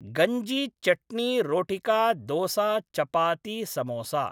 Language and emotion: Sanskrit, neutral